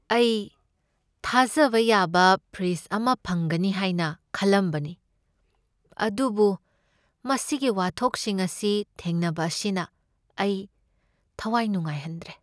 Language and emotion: Manipuri, sad